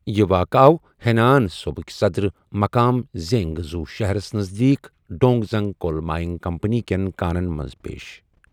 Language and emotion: Kashmiri, neutral